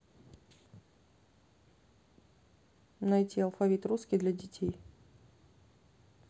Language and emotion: Russian, neutral